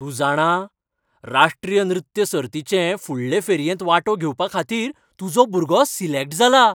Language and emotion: Goan Konkani, happy